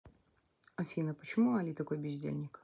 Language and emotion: Russian, neutral